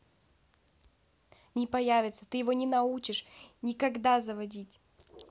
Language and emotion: Russian, angry